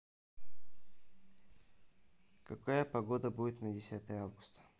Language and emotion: Russian, neutral